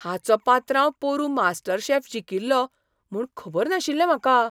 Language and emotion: Goan Konkani, surprised